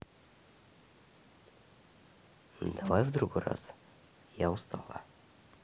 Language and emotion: Russian, neutral